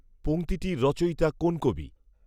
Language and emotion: Bengali, neutral